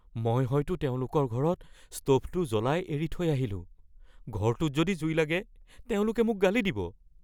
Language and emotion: Assamese, fearful